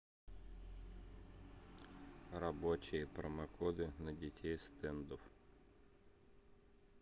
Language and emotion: Russian, neutral